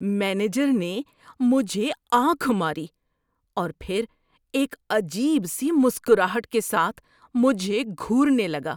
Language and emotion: Urdu, disgusted